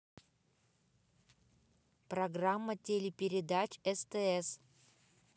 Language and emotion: Russian, neutral